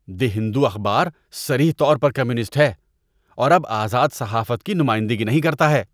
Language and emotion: Urdu, disgusted